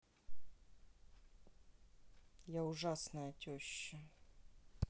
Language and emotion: Russian, sad